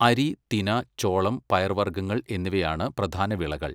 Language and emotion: Malayalam, neutral